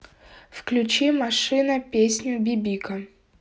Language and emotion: Russian, neutral